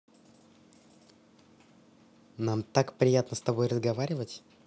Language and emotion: Russian, positive